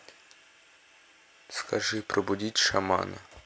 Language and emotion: Russian, neutral